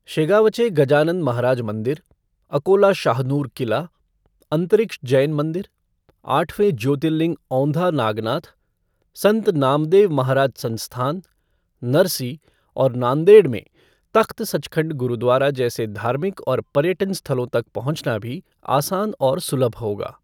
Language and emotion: Hindi, neutral